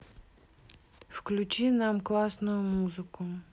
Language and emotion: Russian, neutral